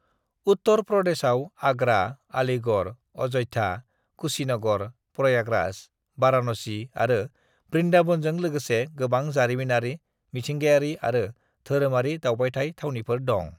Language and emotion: Bodo, neutral